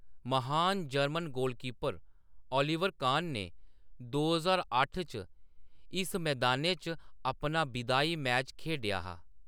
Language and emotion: Dogri, neutral